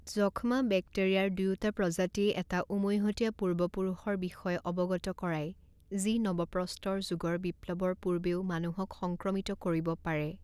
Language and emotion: Assamese, neutral